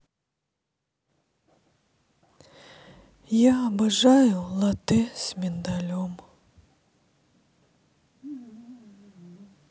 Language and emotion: Russian, sad